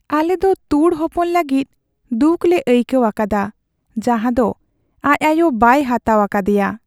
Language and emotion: Santali, sad